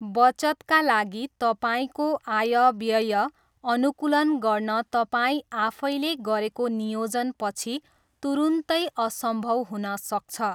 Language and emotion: Nepali, neutral